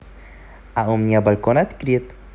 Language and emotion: Russian, positive